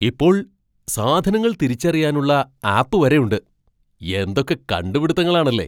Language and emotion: Malayalam, surprised